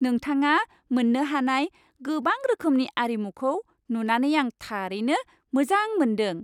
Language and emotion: Bodo, happy